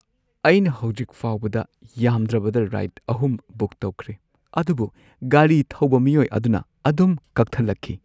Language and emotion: Manipuri, sad